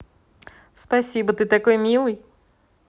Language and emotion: Russian, positive